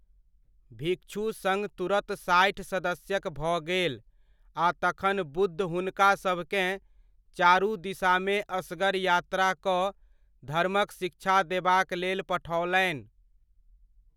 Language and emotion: Maithili, neutral